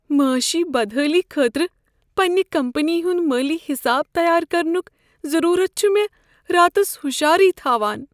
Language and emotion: Kashmiri, fearful